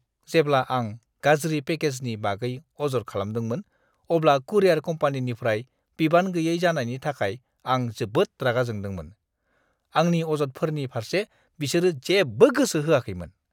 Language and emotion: Bodo, disgusted